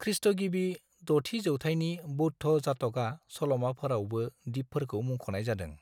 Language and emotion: Bodo, neutral